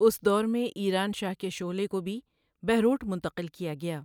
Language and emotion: Urdu, neutral